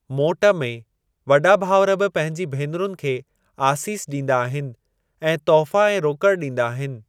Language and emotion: Sindhi, neutral